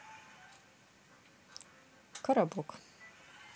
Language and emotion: Russian, neutral